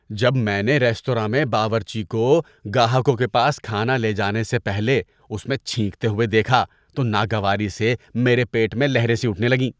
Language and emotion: Urdu, disgusted